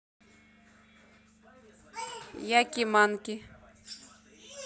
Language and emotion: Russian, neutral